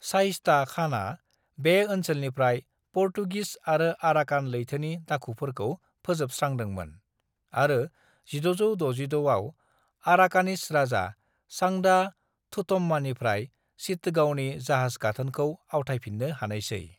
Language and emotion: Bodo, neutral